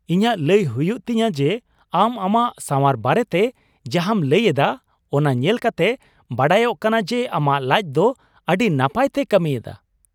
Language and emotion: Santali, surprised